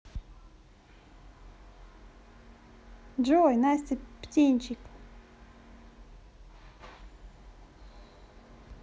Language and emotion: Russian, positive